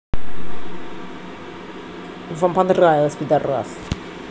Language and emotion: Russian, angry